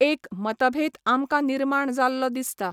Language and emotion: Goan Konkani, neutral